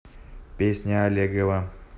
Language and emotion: Russian, neutral